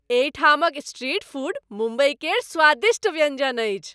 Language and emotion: Maithili, happy